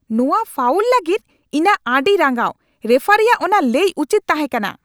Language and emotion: Santali, angry